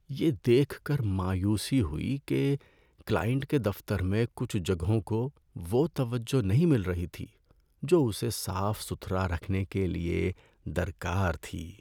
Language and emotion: Urdu, sad